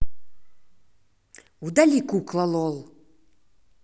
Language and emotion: Russian, angry